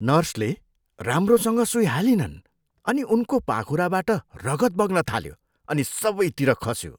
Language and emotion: Nepali, disgusted